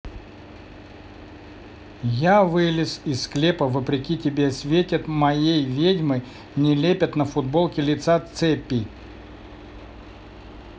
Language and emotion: Russian, neutral